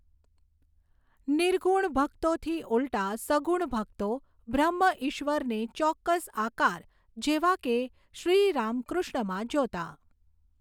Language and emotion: Gujarati, neutral